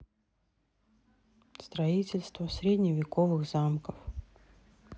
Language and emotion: Russian, sad